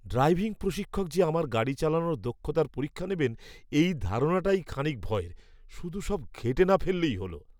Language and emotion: Bengali, fearful